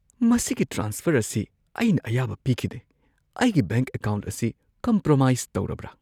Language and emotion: Manipuri, fearful